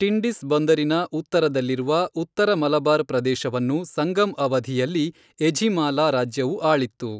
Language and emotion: Kannada, neutral